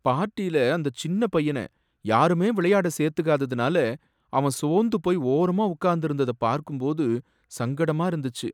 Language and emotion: Tamil, sad